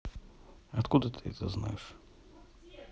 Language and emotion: Russian, neutral